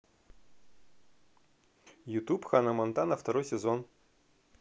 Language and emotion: Russian, positive